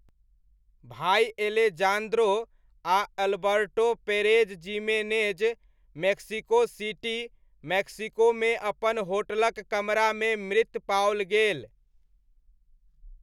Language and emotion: Maithili, neutral